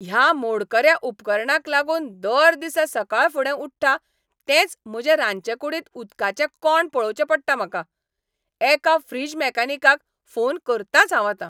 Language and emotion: Goan Konkani, angry